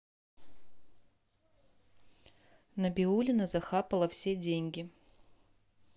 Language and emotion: Russian, neutral